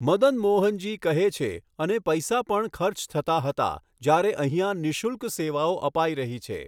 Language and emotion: Gujarati, neutral